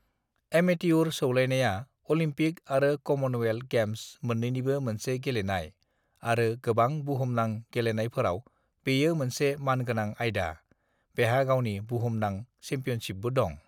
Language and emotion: Bodo, neutral